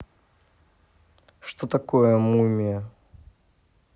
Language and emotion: Russian, neutral